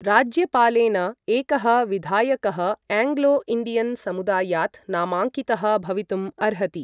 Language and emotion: Sanskrit, neutral